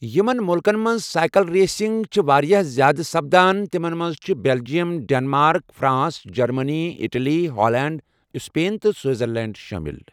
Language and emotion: Kashmiri, neutral